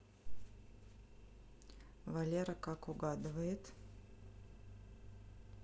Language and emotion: Russian, neutral